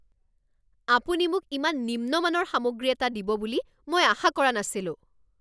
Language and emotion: Assamese, angry